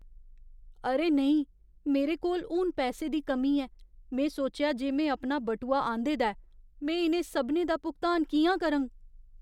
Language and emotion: Dogri, fearful